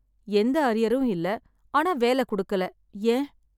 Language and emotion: Tamil, sad